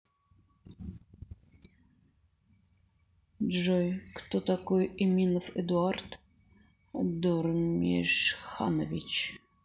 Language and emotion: Russian, neutral